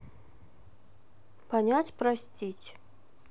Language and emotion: Russian, neutral